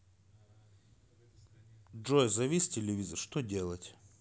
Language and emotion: Russian, neutral